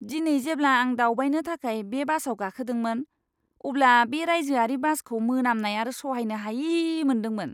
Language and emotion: Bodo, disgusted